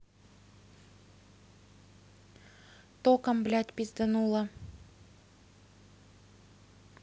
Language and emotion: Russian, angry